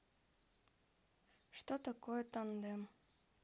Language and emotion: Russian, neutral